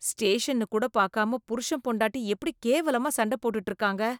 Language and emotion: Tamil, disgusted